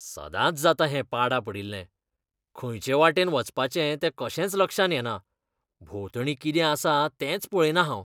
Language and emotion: Goan Konkani, disgusted